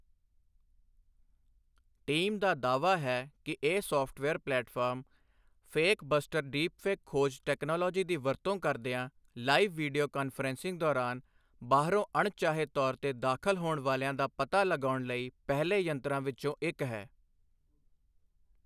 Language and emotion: Punjabi, neutral